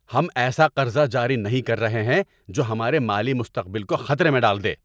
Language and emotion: Urdu, angry